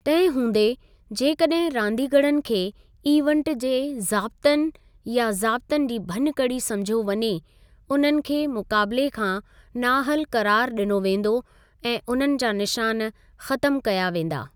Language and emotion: Sindhi, neutral